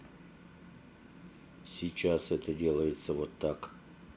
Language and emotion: Russian, neutral